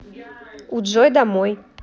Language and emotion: Russian, neutral